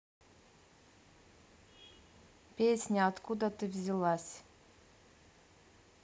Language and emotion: Russian, neutral